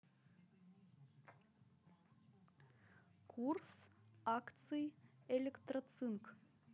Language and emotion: Russian, neutral